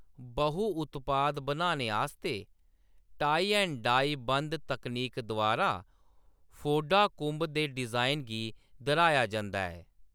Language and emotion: Dogri, neutral